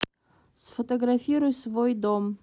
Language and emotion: Russian, neutral